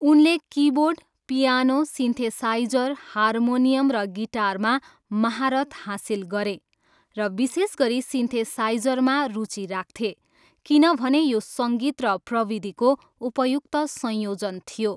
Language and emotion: Nepali, neutral